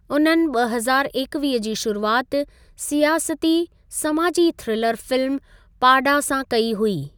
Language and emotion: Sindhi, neutral